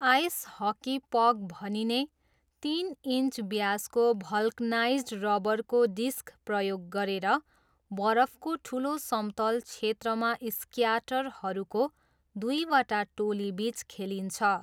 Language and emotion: Nepali, neutral